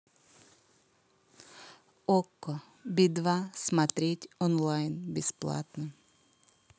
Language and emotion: Russian, neutral